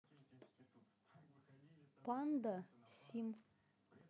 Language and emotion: Russian, neutral